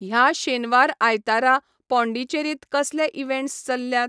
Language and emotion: Goan Konkani, neutral